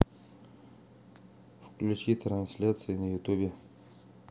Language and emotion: Russian, neutral